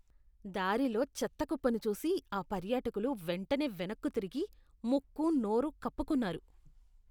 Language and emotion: Telugu, disgusted